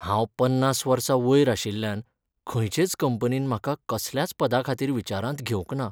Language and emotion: Goan Konkani, sad